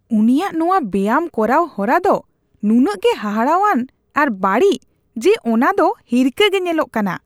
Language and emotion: Santali, disgusted